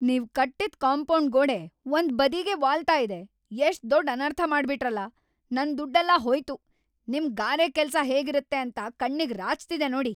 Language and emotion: Kannada, angry